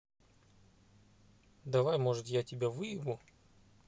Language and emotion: Russian, neutral